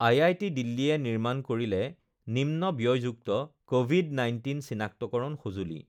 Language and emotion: Assamese, neutral